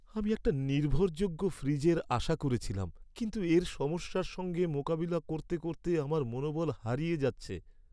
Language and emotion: Bengali, sad